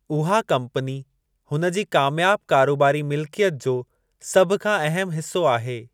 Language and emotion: Sindhi, neutral